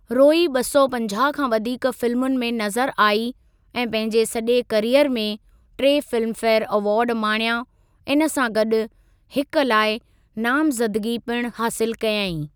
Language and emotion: Sindhi, neutral